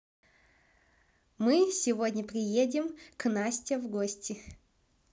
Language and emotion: Russian, positive